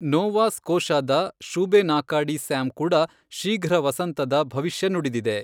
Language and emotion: Kannada, neutral